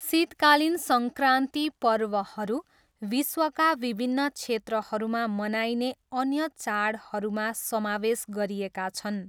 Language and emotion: Nepali, neutral